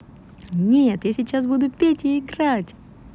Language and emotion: Russian, positive